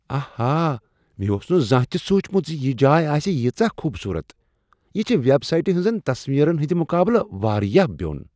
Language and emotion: Kashmiri, surprised